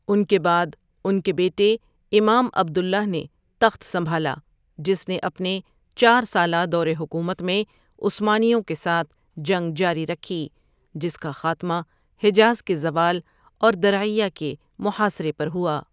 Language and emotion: Urdu, neutral